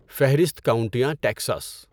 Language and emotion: Urdu, neutral